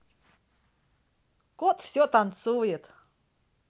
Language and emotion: Russian, positive